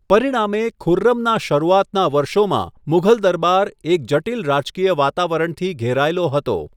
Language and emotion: Gujarati, neutral